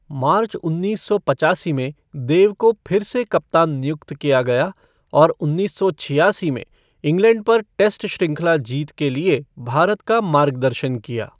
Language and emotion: Hindi, neutral